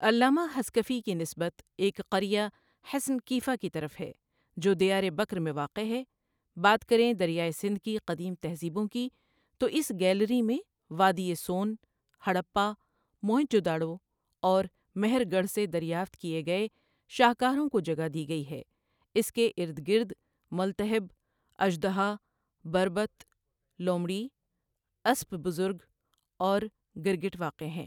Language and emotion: Urdu, neutral